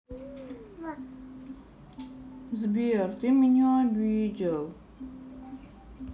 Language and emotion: Russian, sad